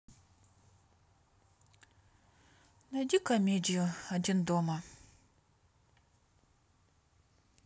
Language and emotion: Russian, sad